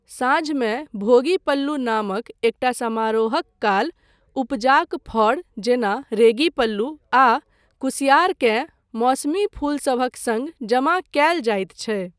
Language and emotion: Maithili, neutral